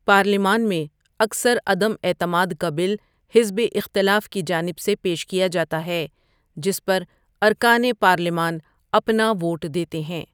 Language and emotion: Urdu, neutral